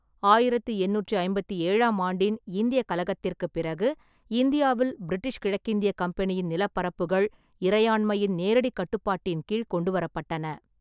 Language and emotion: Tamil, neutral